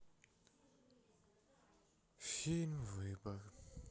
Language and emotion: Russian, sad